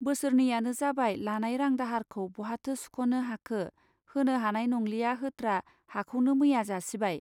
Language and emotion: Bodo, neutral